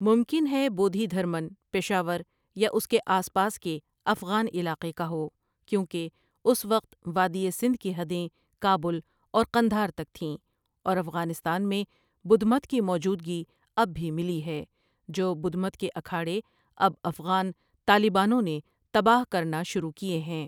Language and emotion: Urdu, neutral